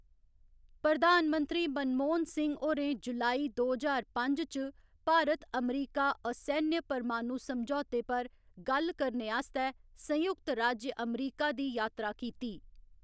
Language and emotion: Dogri, neutral